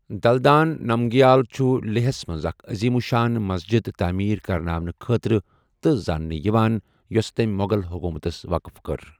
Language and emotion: Kashmiri, neutral